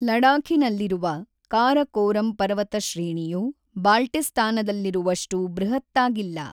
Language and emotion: Kannada, neutral